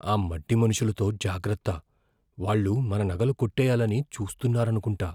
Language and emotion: Telugu, fearful